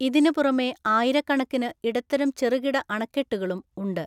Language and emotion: Malayalam, neutral